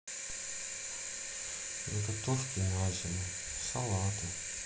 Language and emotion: Russian, sad